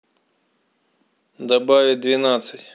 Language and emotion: Russian, neutral